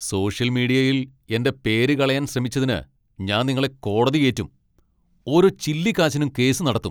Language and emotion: Malayalam, angry